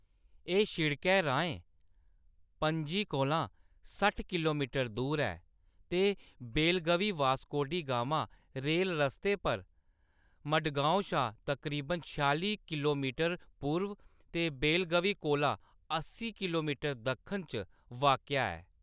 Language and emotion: Dogri, neutral